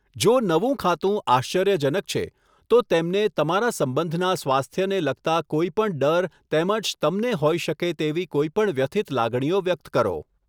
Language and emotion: Gujarati, neutral